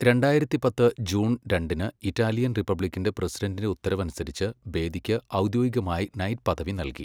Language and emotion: Malayalam, neutral